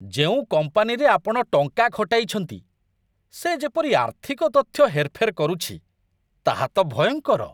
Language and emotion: Odia, disgusted